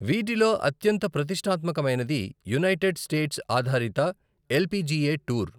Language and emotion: Telugu, neutral